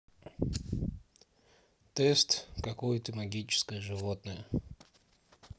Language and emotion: Russian, neutral